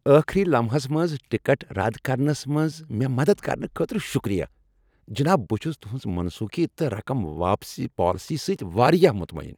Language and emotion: Kashmiri, happy